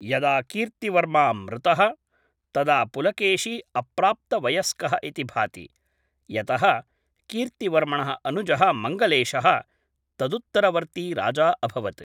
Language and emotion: Sanskrit, neutral